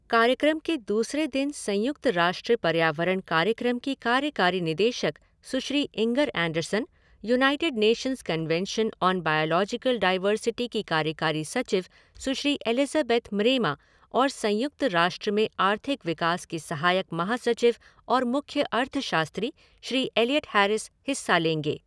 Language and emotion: Hindi, neutral